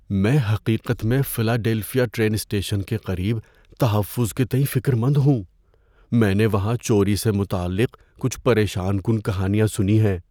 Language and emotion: Urdu, fearful